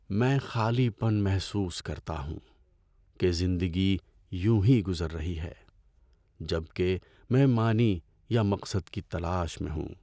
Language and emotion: Urdu, sad